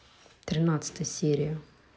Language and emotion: Russian, neutral